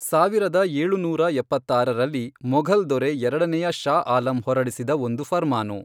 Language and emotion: Kannada, neutral